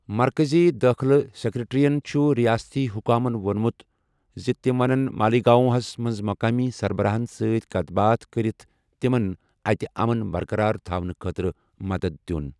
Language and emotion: Kashmiri, neutral